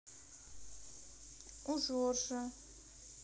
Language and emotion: Russian, neutral